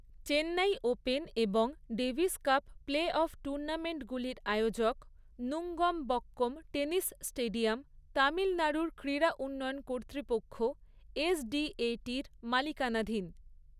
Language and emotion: Bengali, neutral